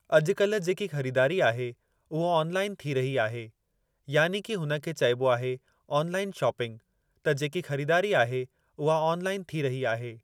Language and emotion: Sindhi, neutral